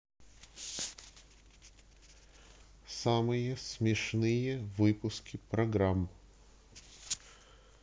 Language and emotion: Russian, neutral